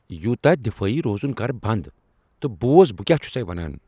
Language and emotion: Kashmiri, angry